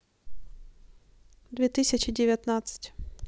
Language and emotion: Russian, neutral